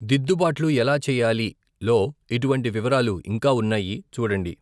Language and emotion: Telugu, neutral